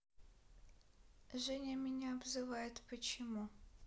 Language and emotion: Russian, sad